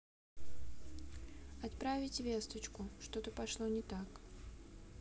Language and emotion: Russian, sad